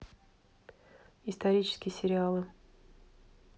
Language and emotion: Russian, neutral